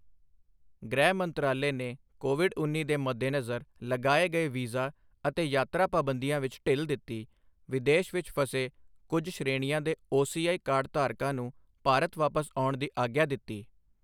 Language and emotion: Punjabi, neutral